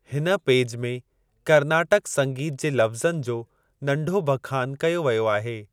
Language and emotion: Sindhi, neutral